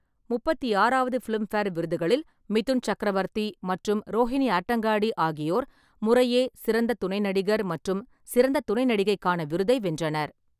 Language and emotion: Tamil, neutral